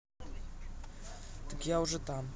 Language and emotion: Russian, neutral